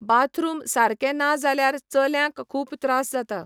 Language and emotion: Goan Konkani, neutral